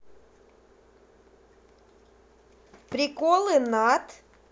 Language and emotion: Russian, positive